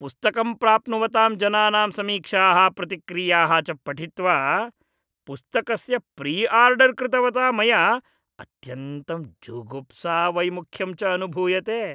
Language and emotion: Sanskrit, disgusted